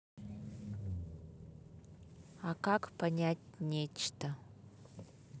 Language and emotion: Russian, neutral